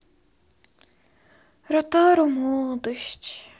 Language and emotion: Russian, sad